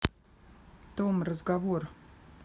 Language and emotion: Russian, neutral